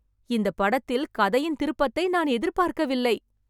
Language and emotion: Tamil, surprised